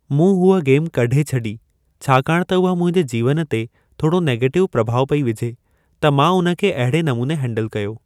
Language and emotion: Sindhi, neutral